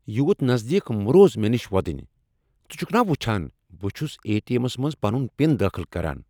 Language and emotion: Kashmiri, angry